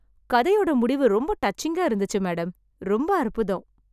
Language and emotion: Tamil, happy